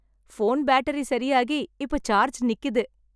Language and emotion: Tamil, happy